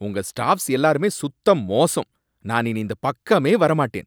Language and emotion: Tamil, angry